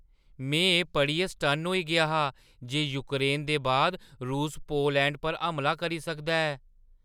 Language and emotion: Dogri, surprised